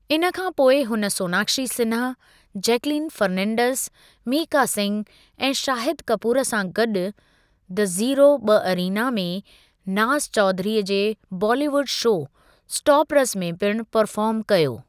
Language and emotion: Sindhi, neutral